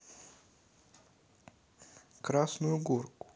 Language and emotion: Russian, neutral